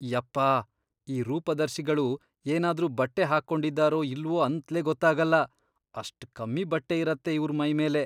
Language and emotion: Kannada, disgusted